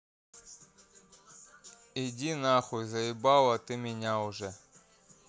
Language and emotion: Russian, angry